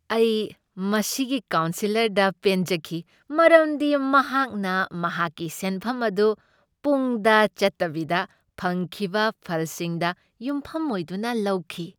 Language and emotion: Manipuri, happy